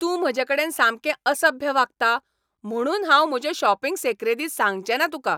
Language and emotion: Goan Konkani, angry